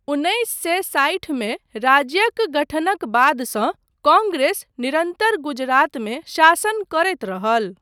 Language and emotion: Maithili, neutral